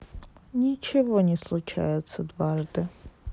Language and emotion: Russian, sad